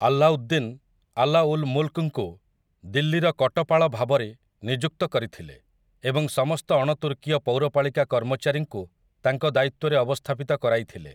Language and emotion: Odia, neutral